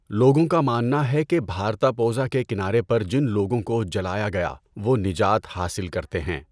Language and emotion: Urdu, neutral